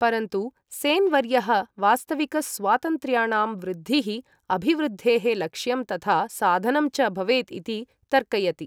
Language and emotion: Sanskrit, neutral